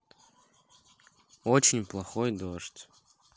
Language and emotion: Russian, neutral